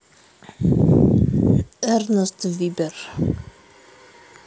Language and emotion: Russian, neutral